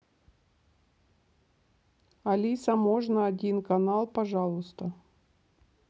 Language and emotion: Russian, neutral